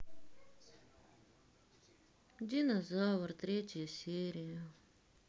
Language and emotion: Russian, sad